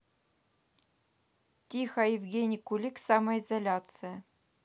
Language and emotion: Russian, neutral